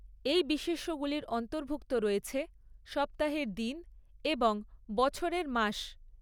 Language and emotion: Bengali, neutral